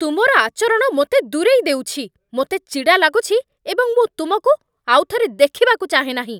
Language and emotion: Odia, angry